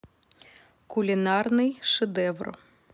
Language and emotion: Russian, neutral